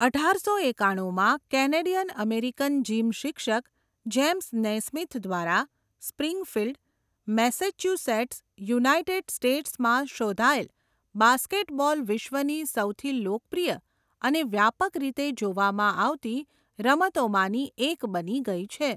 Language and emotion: Gujarati, neutral